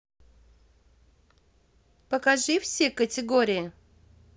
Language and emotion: Russian, positive